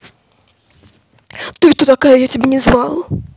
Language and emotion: Russian, angry